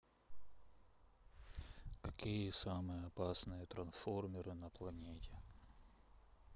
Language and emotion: Russian, sad